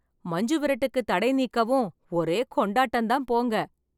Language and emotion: Tamil, happy